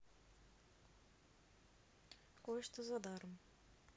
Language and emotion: Russian, neutral